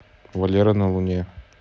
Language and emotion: Russian, neutral